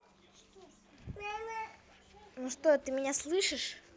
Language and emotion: Russian, positive